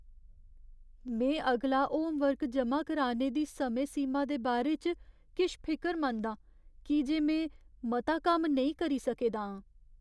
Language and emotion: Dogri, fearful